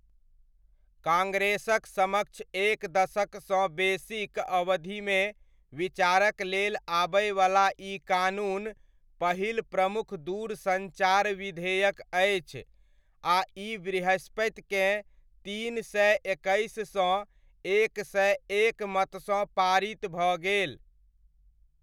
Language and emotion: Maithili, neutral